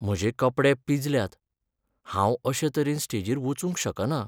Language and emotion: Goan Konkani, sad